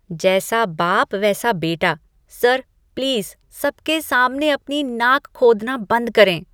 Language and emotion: Hindi, disgusted